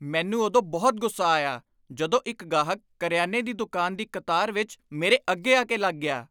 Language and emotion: Punjabi, angry